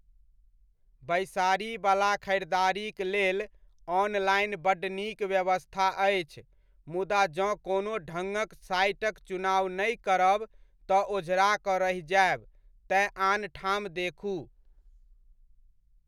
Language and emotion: Maithili, neutral